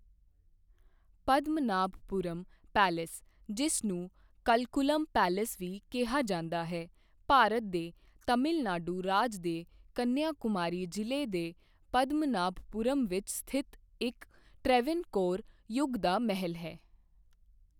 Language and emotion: Punjabi, neutral